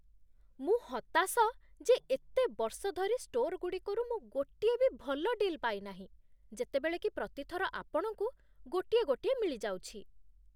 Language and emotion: Odia, disgusted